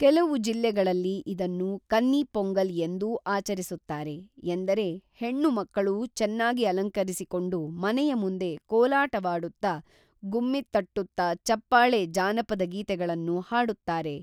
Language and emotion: Kannada, neutral